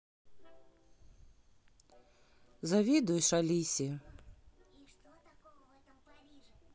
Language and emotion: Russian, sad